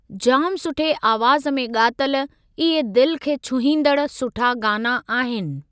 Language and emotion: Sindhi, neutral